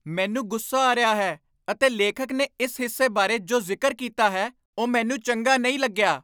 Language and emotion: Punjabi, angry